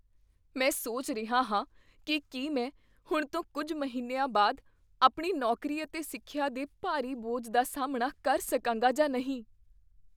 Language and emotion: Punjabi, fearful